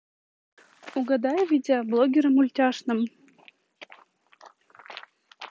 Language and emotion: Russian, neutral